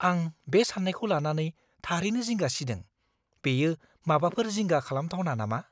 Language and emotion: Bodo, fearful